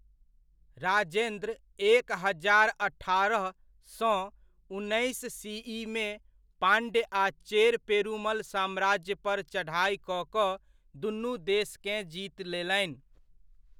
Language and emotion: Maithili, neutral